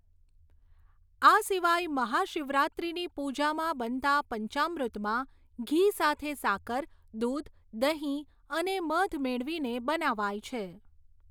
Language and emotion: Gujarati, neutral